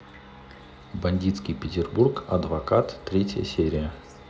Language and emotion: Russian, neutral